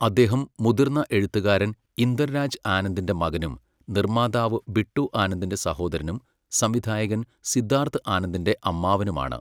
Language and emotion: Malayalam, neutral